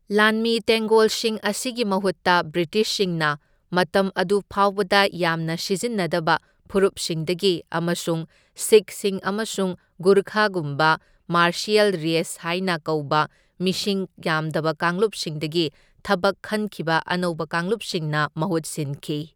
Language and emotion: Manipuri, neutral